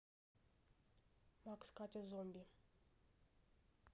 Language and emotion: Russian, neutral